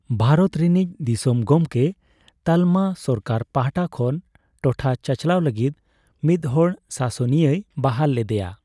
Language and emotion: Santali, neutral